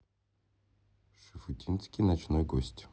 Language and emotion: Russian, neutral